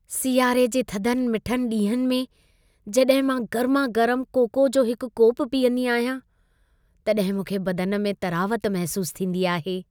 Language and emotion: Sindhi, happy